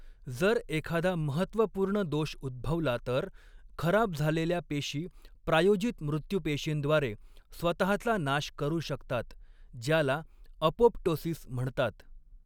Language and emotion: Marathi, neutral